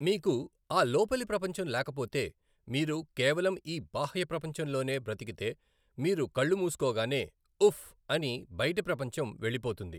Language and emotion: Telugu, neutral